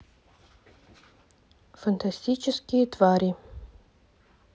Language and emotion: Russian, neutral